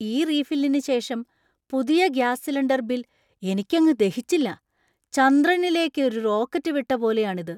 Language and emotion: Malayalam, surprised